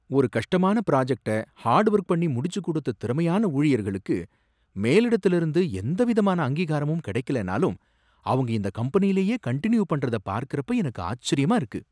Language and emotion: Tamil, surprised